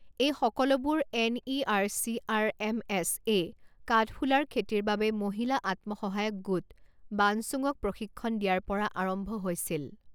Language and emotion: Assamese, neutral